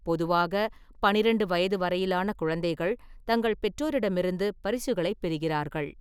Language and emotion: Tamil, neutral